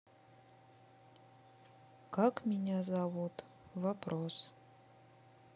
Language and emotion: Russian, sad